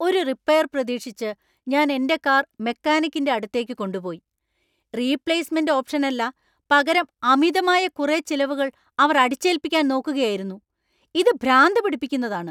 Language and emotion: Malayalam, angry